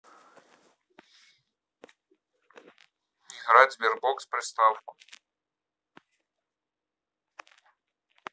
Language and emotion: Russian, neutral